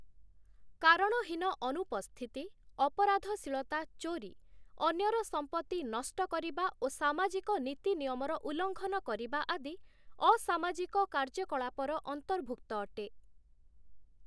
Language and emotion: Odia, neutral